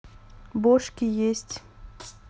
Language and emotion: Russian, neutral